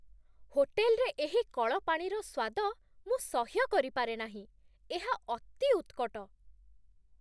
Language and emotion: Odia, disgusted